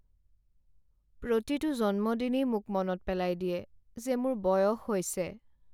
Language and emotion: Assamese, sad